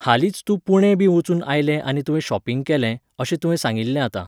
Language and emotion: Goan Konkani, neutral